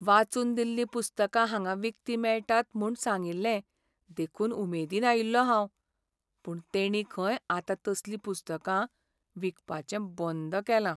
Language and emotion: Goan Konkani, sad